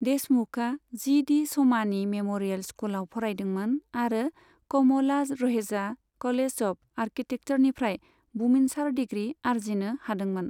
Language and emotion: Bodo, neutral